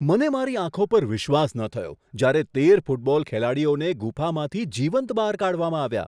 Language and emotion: Gujarati, surprised